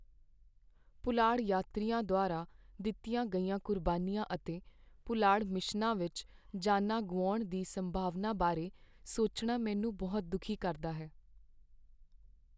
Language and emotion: Punjabi, sad